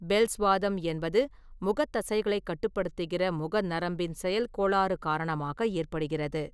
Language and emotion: Tamil, neutral